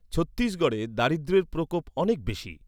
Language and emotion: Bengali, neutral